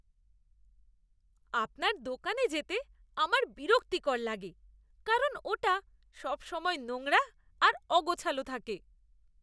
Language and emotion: Bengali, disgusted